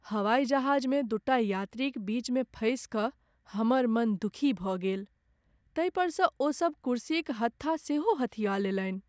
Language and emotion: Maithili, sad